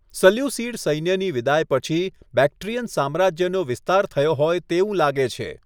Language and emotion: Gujarati, neutral